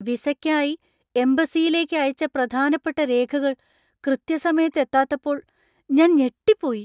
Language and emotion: Malayalam, surprised